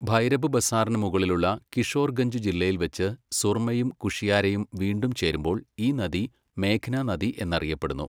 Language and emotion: Malayalam, neutral